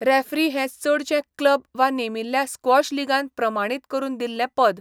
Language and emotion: Goan Konkani, neutral